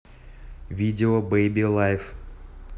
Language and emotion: Russian, neutral